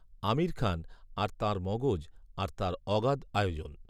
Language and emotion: Bengali, neutral